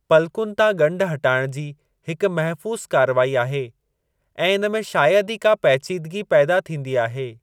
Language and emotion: Sindhi, neutral